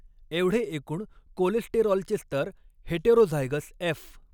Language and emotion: Marathi, neutral